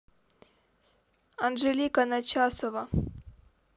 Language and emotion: Russian, neutral